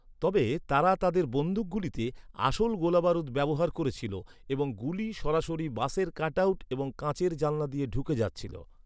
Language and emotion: Bengali, neutral